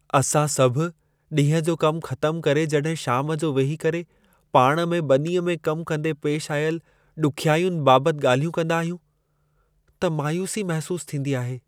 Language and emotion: Sindhi, sad